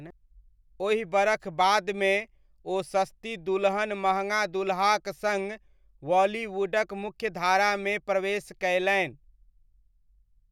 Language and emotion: Maithili, neutral